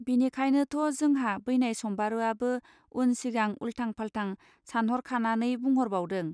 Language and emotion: Bodo, neutral